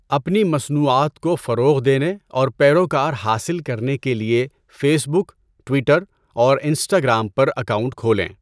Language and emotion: Urdu, neutral